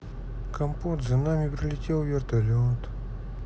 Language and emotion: Russian, sad